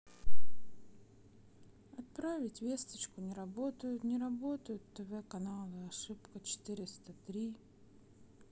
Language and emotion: Russian, sad